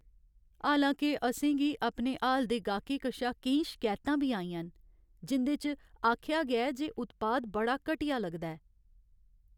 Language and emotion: Dogri, sad